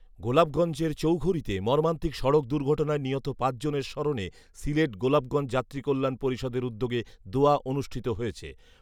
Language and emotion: Bengali, neutral